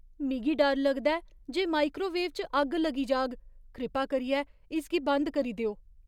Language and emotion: Dogri, fearful